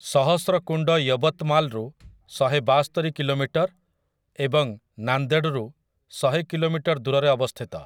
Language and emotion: Odia, neutral